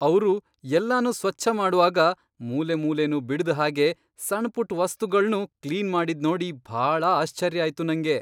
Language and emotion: Kannada, surprised